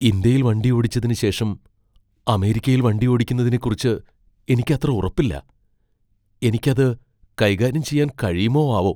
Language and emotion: Malayalam, fearful